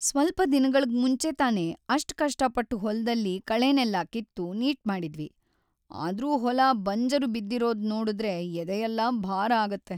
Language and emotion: Kannada, sad